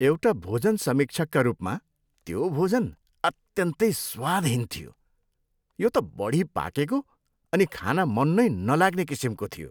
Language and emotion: Nepali, disgusted